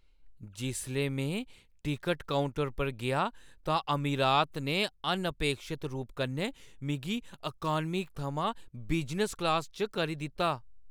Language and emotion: Dogri, surprised